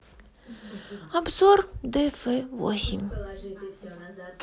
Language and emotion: Russian, sad